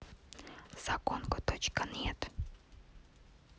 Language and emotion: Russian, neutral